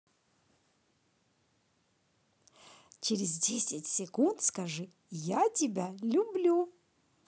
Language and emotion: Russian, positive